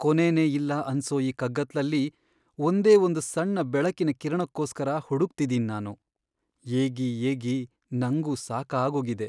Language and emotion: Kannada, sad